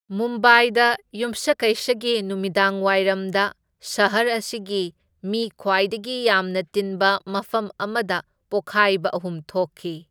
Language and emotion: Manipuri, neutral